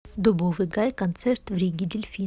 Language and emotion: Russian, neutral